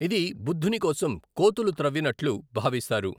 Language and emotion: Telugu, neutral